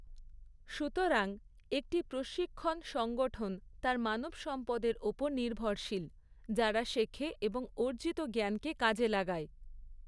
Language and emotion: Bengali, neutral